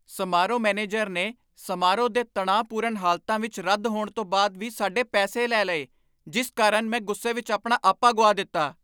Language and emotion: Punjabi, angry